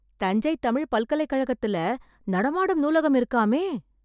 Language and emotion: Tamil, surprised